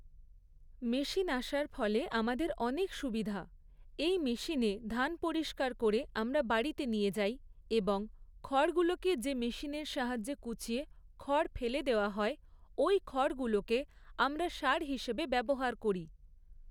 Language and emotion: Bengali, neutral